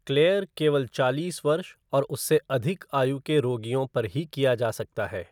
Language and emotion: Hindi, neutral